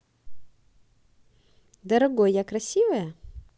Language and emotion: Russian, positive